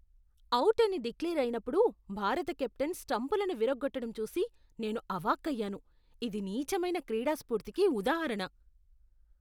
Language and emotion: Telugu, disgusted